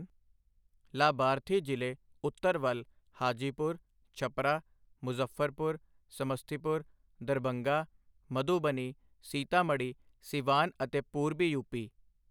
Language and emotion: Punjabi, neutral